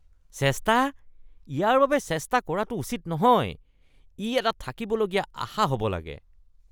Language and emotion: Assamese, disgusted